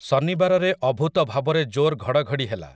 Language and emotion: Odia, neutral